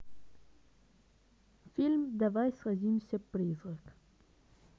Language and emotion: Russian, neutral